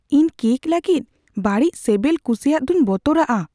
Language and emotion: Santali, fearful